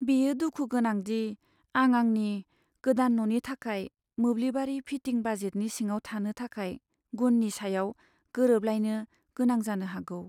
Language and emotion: Bodo, sad